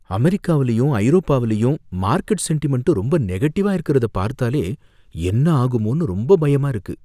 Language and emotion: Tamil, fearful